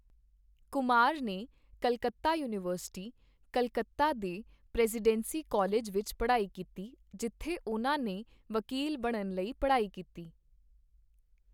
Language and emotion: Punjabi, neutral